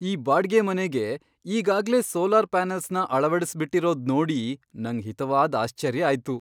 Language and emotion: Kannada, surprised